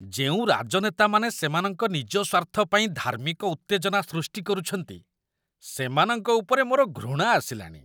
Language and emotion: Odia, disgusted